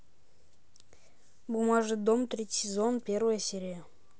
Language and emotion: Russian, neutral